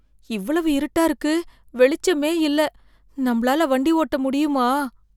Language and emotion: Tamil, fearful